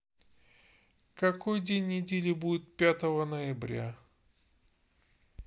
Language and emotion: Russian, neutral